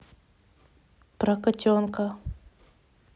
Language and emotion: Russian, neutral